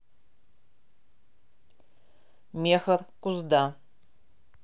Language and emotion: Russian, neutral